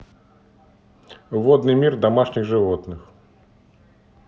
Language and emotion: Russian, neutral